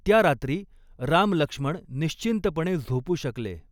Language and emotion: Marathi, neutral